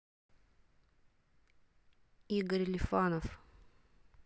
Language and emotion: Russian, neutral